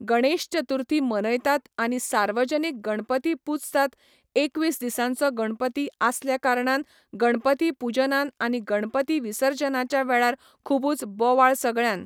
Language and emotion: Goan Konkani, neutral